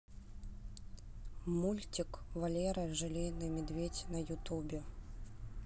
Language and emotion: Russian, neutral